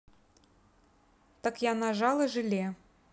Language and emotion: Russian, neutral